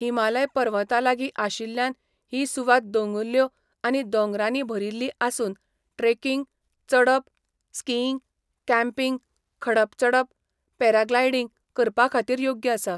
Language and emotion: Goan Konkani, neutral